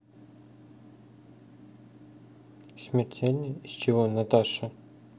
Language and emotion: Russian, sad